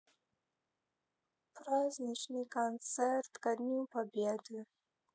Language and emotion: Russian, sad